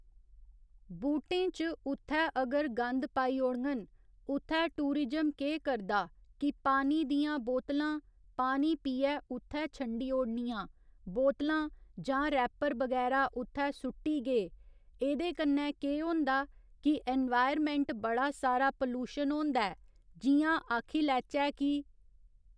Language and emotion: Dogri, neutral